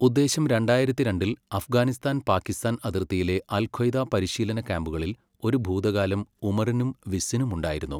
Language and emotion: Malayalam, neutral